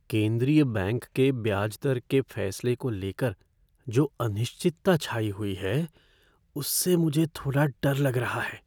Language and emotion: Hindi, fearful